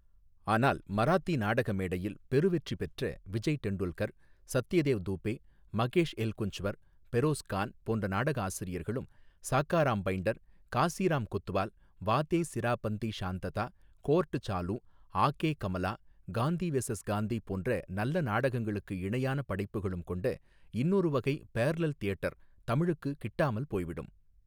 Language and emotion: Tamil, neutral